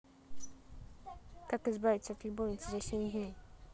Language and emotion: Russian, neutral